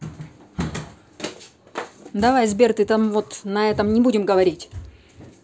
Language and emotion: Russian, angry